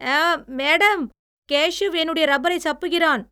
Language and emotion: Tamil, disgusted